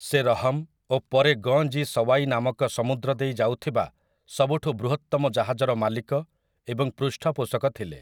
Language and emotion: Odia, neutral